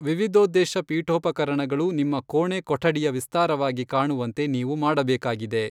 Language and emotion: Kannada, neutral